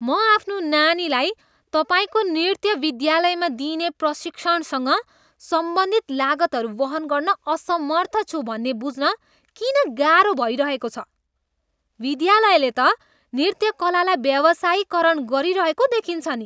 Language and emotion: Nepali, disgusted